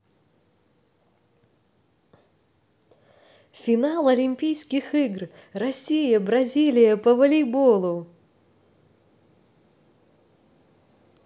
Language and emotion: Russian, positive